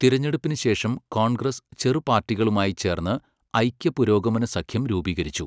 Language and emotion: Malayalam, neutral